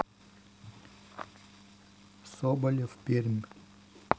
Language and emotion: Russian, neutral